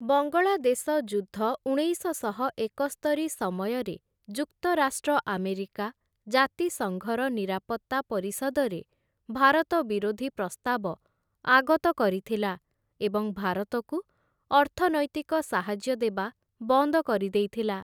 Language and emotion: Odia, neutral